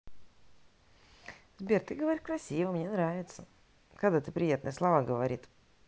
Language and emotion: Russian, neutral